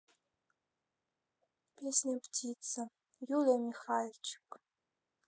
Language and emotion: Russian, neutral